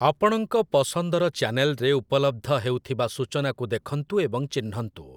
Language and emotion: Odia, neutral